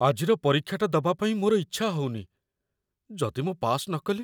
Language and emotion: Odia, fearful